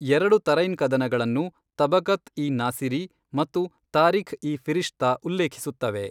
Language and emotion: Kannada, neutral